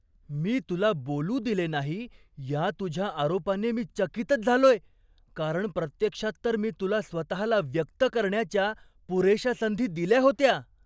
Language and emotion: Marathi, surprised